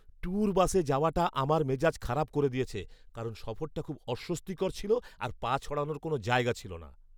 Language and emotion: Bengali, angry